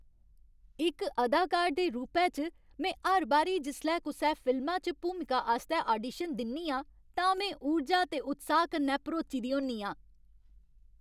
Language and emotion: Dogri, happy